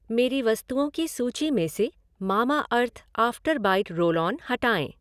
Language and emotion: Hindi, neutral